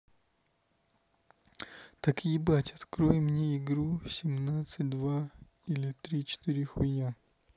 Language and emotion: Russian, neutral